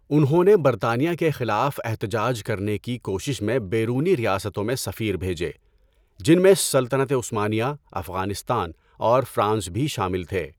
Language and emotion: Urdu, neutral